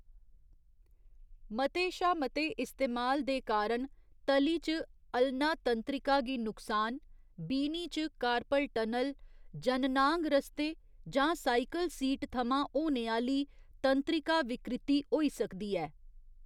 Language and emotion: Dogri, neutral